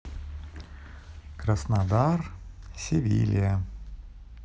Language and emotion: Russian, neutral